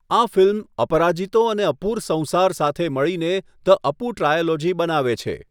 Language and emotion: Gujarati, neutral